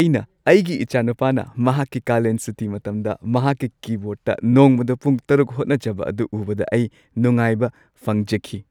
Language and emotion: Manipuri, happy